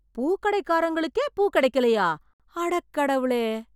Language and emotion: Tamil, surprised